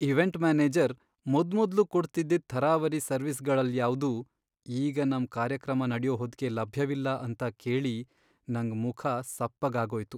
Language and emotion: Kannada, sad